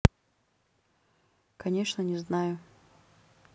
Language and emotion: Russian, neutral